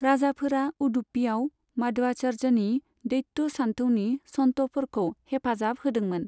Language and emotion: Bodo, neutral